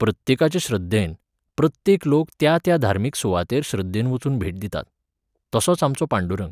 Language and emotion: Goan Konkani, neutral